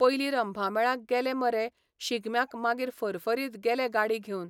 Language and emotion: Goan Konkani, neutral